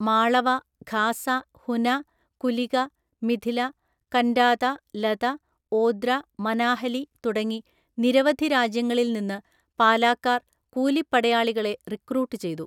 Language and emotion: Malayalam, neutral